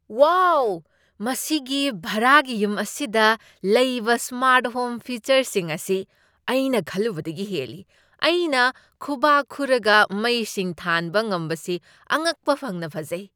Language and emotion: Manipuri, surprised